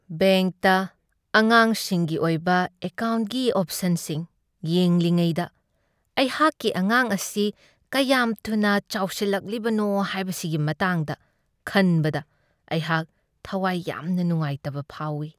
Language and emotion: Manipuri, sad